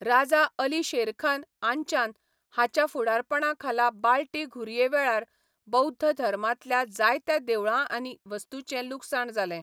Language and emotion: Goan Konkani, neutral